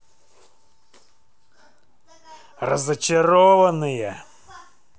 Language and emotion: Russian, angry